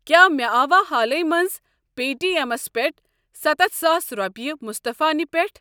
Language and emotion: Kashmiri, neutral